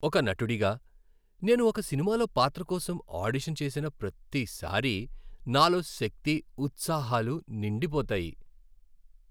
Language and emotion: Telugu, happy